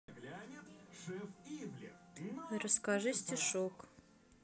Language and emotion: Russian, neutral